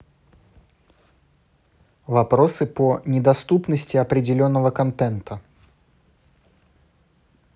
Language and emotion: Russian, neutral